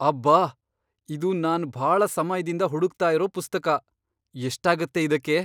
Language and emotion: Kannada, surprised